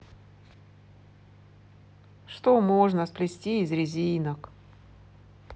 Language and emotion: Russian, sad